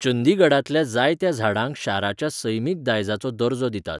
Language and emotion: Goan Konkani, neutral